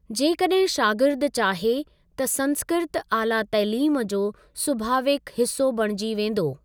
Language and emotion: Sindhi, neutral